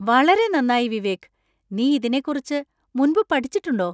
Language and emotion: Malayalam, surprised